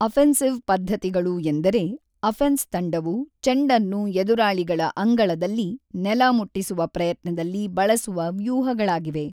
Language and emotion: Kannada, neutral